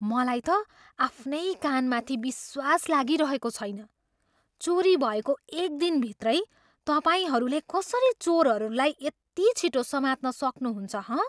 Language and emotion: Nepali, surprised